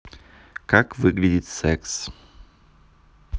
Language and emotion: Russian, neutral